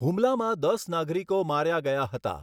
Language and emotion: Gujarati, neutral